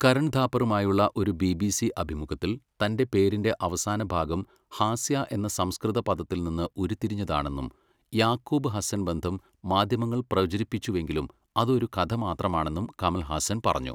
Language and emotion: Malayalam, neutral